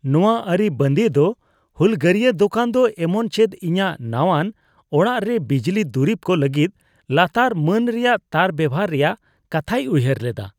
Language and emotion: Santali, disgusted